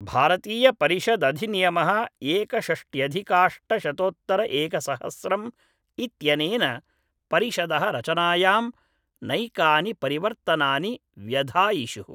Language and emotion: Sanskrit, neutral